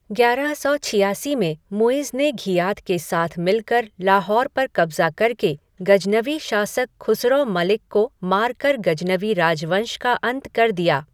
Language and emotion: Hindi, neutral